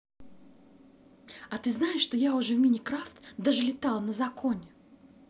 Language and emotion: Russian, positive